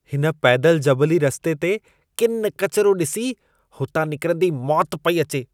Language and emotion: Sindhi, disgusted